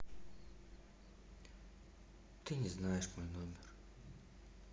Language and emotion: Russian, sad